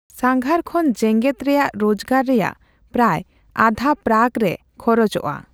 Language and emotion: Santali, neutral